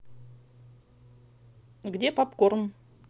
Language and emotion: Russian, neutral